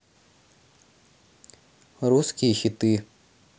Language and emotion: Russian, neutral